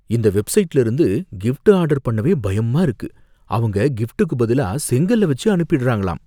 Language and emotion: Tamil, fearful